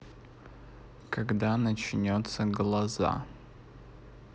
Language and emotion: Russian, neutral